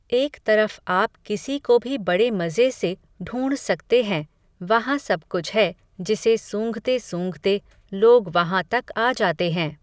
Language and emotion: Hindi, neutral